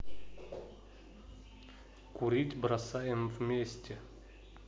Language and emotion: Russian, neutral